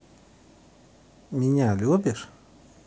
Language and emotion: Russian, neutral